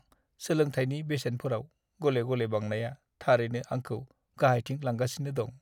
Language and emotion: Bodo, sad